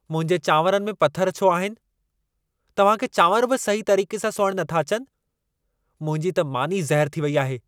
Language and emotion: Sindhi, angry